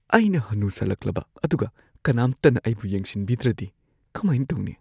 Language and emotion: Manipuri, fearful